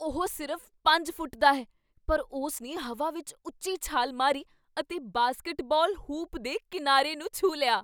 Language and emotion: Punjabi, surprised